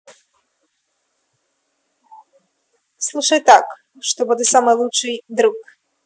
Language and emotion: Russian, positive